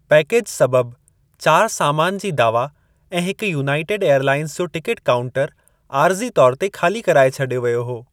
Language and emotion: Sindhi, neutral